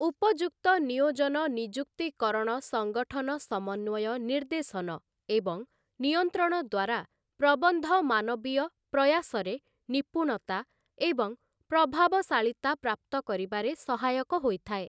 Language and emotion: Odia, neutral